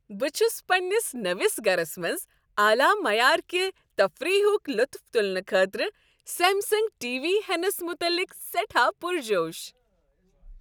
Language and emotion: Kashmiri, happy